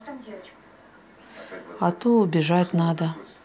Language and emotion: Russian, sad